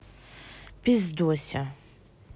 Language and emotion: Russian, sad